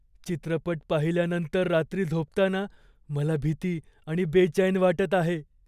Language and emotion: Marathi, fearful